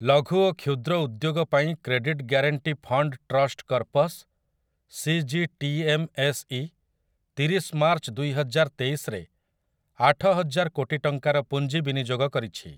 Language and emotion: Odia, neutral